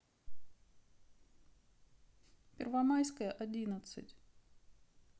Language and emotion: Russian, sad